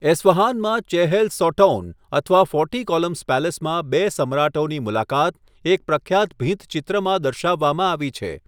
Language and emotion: Gujarati, neutral